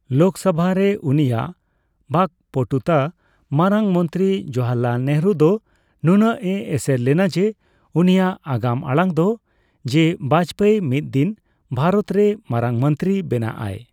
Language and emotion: Santali, neutral